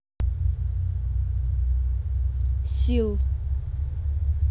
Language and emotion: Russian, neutral